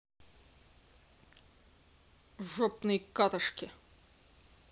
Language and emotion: Russian, angry